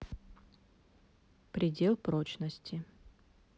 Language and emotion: Russian, neutral